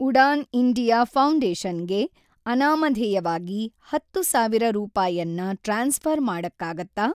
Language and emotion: Kannada, neutral